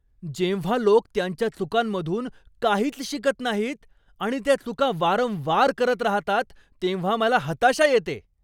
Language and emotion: Marathi, angry